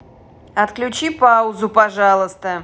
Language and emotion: Russian, angry